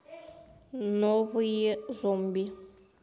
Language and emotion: Russian, neutral